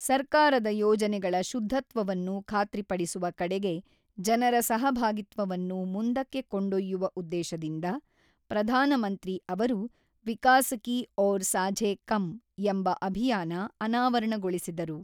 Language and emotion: Kannada, neutral